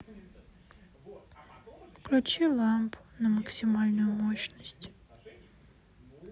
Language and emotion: Russian, sad